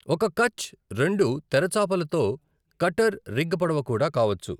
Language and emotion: Telugu, neutral